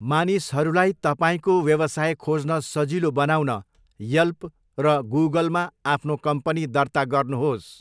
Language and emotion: Nepali, neutral